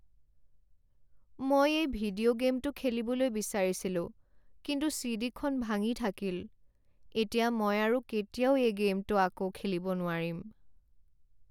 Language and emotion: Assamese, sad